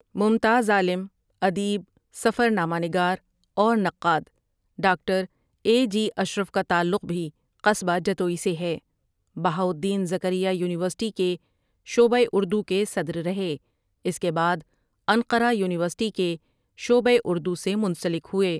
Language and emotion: Urdu, neutral